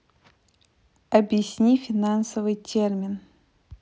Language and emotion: Russian, neutral